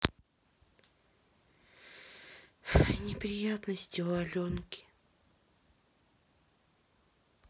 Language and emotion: Russian, sad